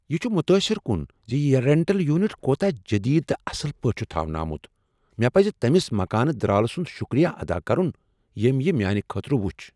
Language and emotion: Kashmiri, surprised